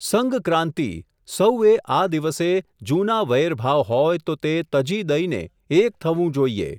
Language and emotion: Gujarati, neutral